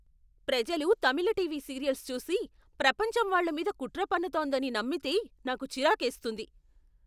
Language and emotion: Telugu, angry